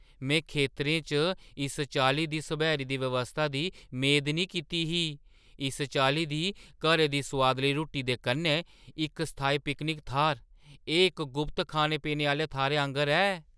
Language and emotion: Dogri, surprised